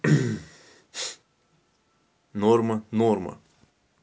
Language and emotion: Russian, neutral